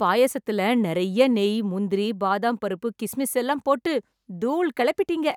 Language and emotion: Tamil, happy